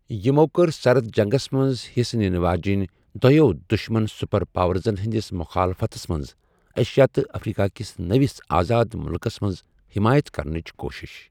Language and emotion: Kashmiri, neutral